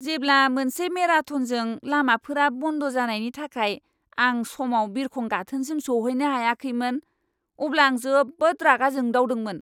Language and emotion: Bodo, angry